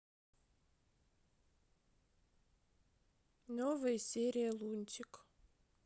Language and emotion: Russian, sad